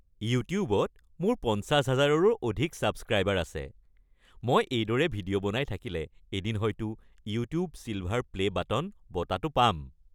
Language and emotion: Assamese, happy